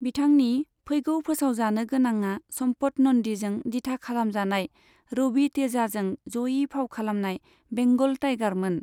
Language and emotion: Bodo, neutral